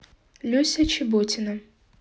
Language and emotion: Russian, neutral